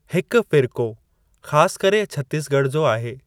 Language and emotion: Sindhi, neutral